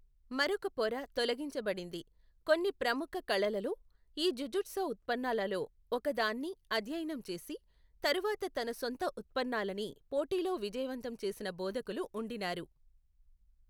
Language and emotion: Telugu, neutral